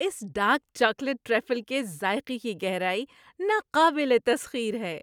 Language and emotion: Urdu, happy